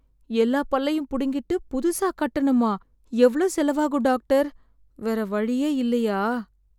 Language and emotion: Tamil, sad